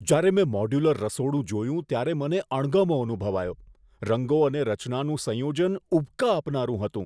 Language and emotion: Gujarati, disgusted